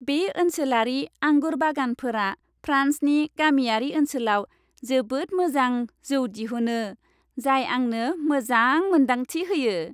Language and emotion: Bodo, happy